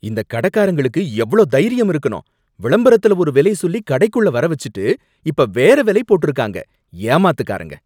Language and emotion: Tamil, angry